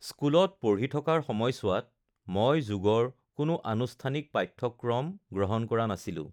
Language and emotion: Assamese, neutral